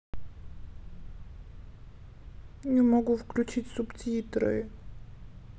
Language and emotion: Russian, sad